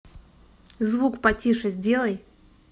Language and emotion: Russian, angry